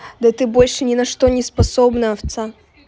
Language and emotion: Russian, angry